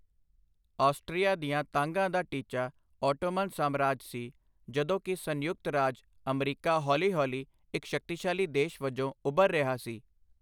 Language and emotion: Punjabi, neutral